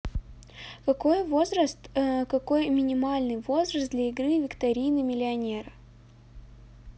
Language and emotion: Russian, neutral